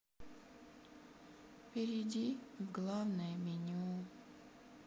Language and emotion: Russian, sad